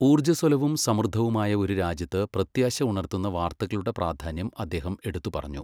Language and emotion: Malayalam, neutral